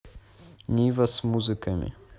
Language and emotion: Russian, neutral